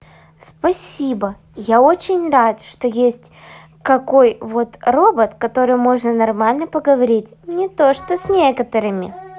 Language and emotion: Russian, positive